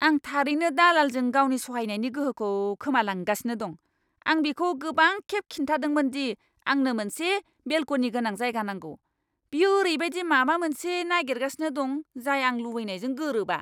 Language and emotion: Bodo, angry